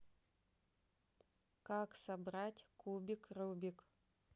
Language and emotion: Russian, neutral